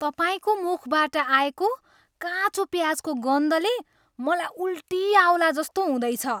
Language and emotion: Nepali, disgusted